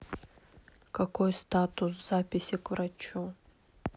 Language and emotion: Russian, neutral